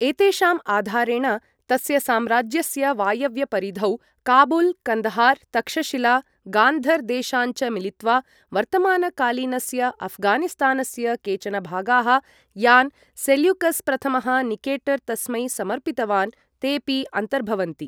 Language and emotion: Sanskrit, neutral